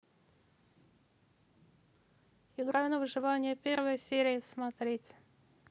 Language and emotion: Russian, neutral